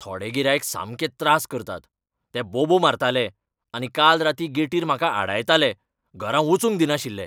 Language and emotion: Goan Konkani, angry